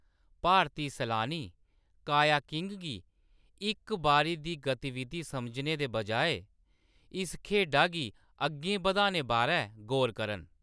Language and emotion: Dogri, neutral